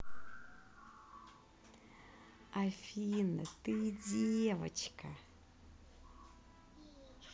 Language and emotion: Russian, positive